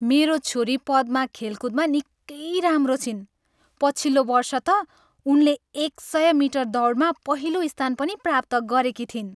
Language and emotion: Nepali, happy